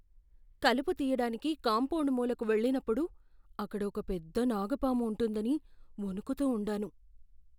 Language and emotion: Telugu, fearful